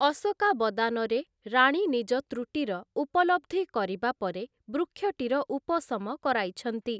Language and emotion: Odia, neutral